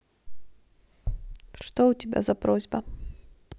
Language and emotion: Russian, neutral